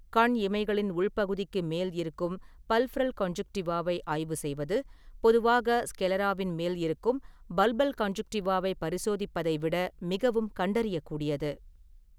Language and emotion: Tamil, neutral